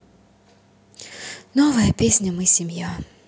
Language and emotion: Russian, neutral